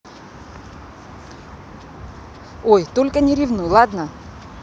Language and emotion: Russian, neutral